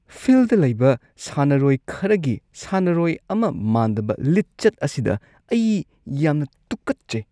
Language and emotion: Manipuri, disgusted